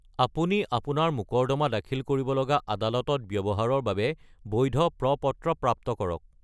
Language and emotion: Assamese, neutral